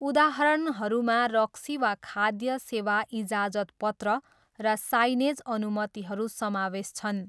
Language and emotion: Nepali, neutral